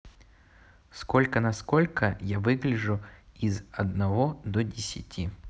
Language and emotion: Russian, neutral